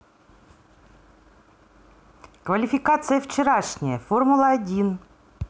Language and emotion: Russian, positive